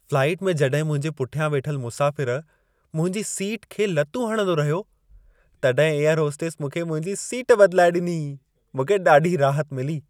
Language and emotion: Sindhi, happy